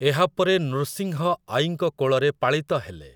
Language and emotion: Odia, neutral